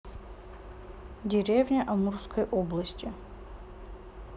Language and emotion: Russian, neutral